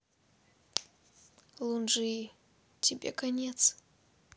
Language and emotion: Russian, sad